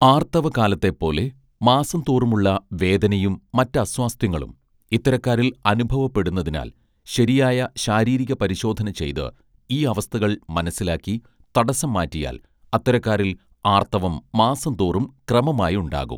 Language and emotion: Malayalam, neutral